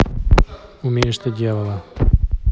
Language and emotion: Russian, neutral